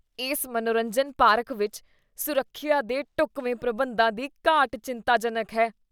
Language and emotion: Punjabi, disgusted